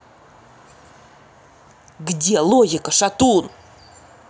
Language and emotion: Russian, angry